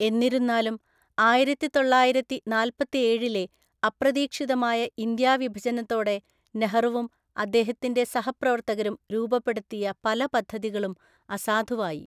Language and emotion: Malayalam, neutral